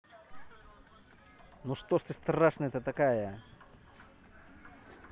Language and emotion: Russian, angry